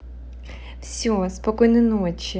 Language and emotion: Russian, positive